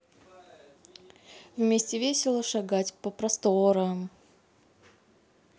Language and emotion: Russian, neutral